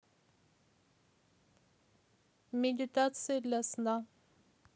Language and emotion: Russian, neutral